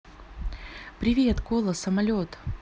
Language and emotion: Russian, positive